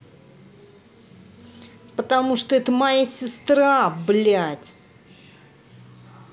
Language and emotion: Russian, angry